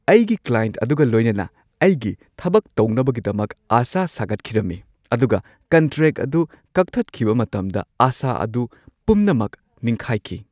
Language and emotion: Manipuri, surprised